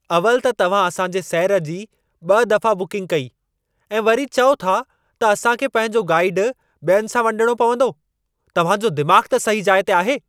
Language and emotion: Sindhi, angry